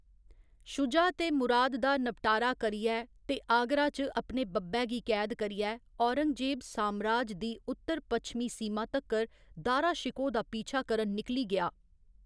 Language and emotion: Dogri, neutral